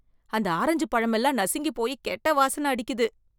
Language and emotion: Tamil, disgusted